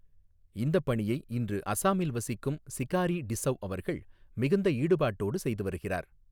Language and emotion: Tamil, neutral